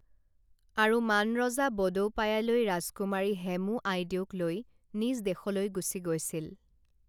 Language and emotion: Assamese, neutral